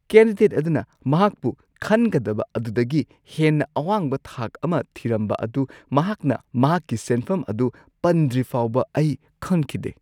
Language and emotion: Manipuri, surprised